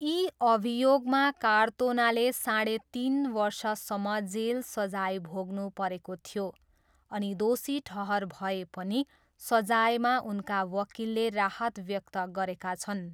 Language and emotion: Nepali, neutral